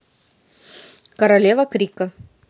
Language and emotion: Russian, neutral